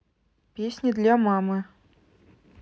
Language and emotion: Russian, neutral